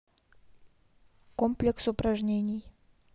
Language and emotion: Russian, neutral